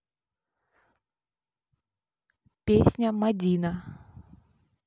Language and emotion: Russian, neutral